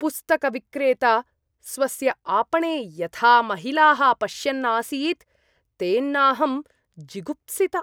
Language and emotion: Sanskrit, disgusted